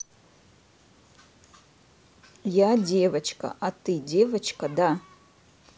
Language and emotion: Russian, neutral